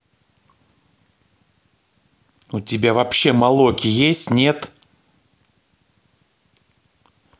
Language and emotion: Russian, angry